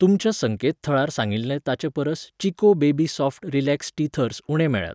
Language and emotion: Goan Konkani, neutral